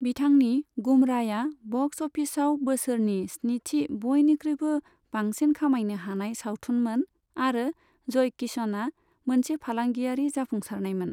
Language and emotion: Bodo, neutral